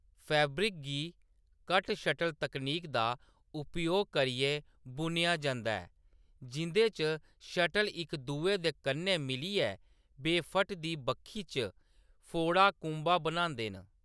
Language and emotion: Dogri, neutral